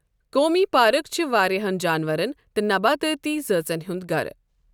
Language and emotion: Kashmiri, neutral